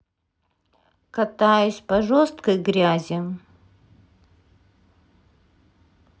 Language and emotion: Russian, sad